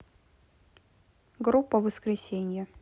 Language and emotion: Russian, neutral